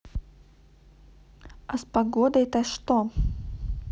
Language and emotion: Russian, neutral